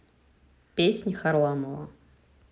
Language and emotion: Russian, neutral